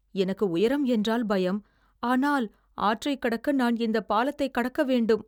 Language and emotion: Tamil, fearful